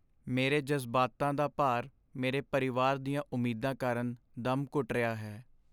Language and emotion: Punjabi, sad